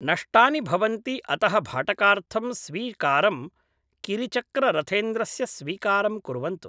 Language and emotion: Sanskrit, neutral